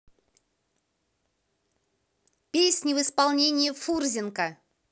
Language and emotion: Russian, positive